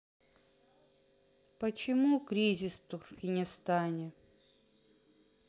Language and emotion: Russian, neutral